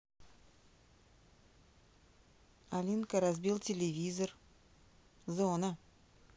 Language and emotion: Russian, neutral